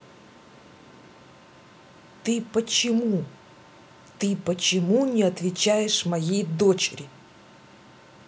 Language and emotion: Russian, angry